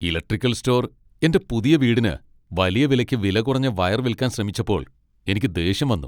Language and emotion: Malayalam, angry